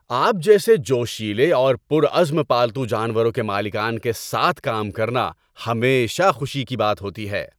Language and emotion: Urdu, happy